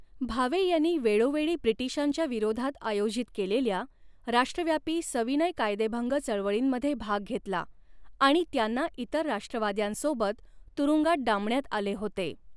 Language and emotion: Marathi, neutral